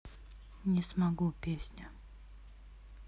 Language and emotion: Russian, neutral